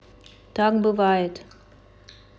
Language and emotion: Russian, neutral